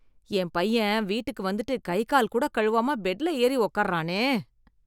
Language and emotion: Tamil, disgusted